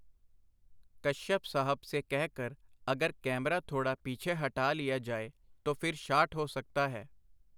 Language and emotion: Punjabi, neutral